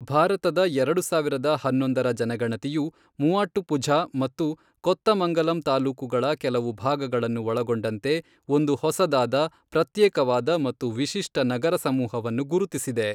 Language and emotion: Kannada, neutral